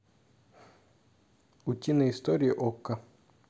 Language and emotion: Russian, neutral